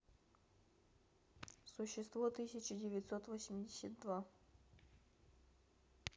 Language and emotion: Russian, neutral